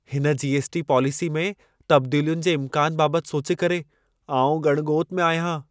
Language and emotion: Sindhi, fearful